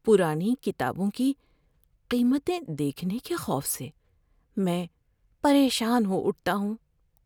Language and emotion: Urdu, fearful